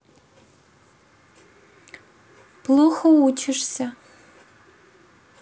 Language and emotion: Russian, neutral